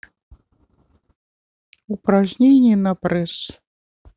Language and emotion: Russian, neutral